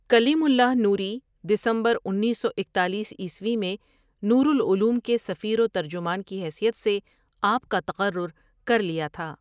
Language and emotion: Urdu, neutral